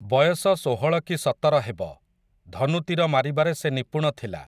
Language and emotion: Odia, neutral